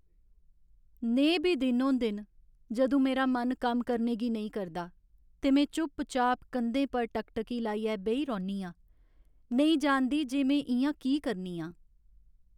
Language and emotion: Dogri, sad